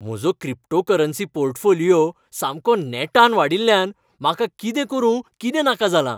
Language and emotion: Goan Konkani, happy